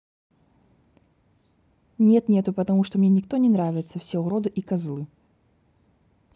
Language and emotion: Russian, neutral